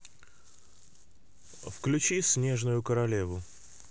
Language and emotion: Russian, neutral